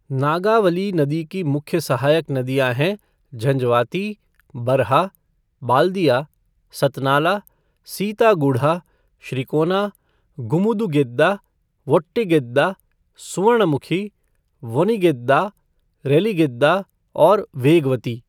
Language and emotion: Hindi, neutral